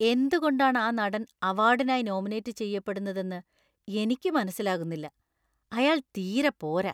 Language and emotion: Malayalam, disgusted